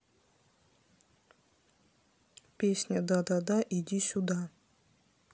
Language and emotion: Russian, neutral